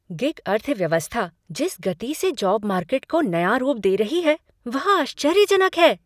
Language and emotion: Hindi, surprised